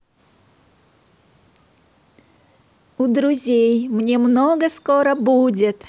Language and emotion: Russian, positive